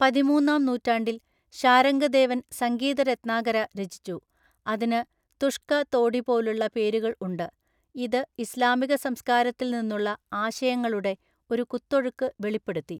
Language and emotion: Malayalam, neutral